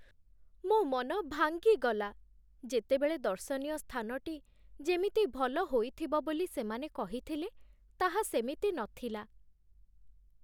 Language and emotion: Odia, sad